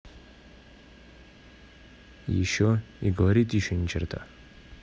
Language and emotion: Russian, neutral